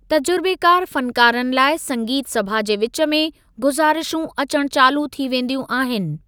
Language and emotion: Sindhi, neutral